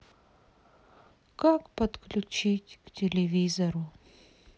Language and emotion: Russian, sad